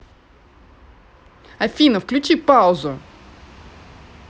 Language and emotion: Russian, angry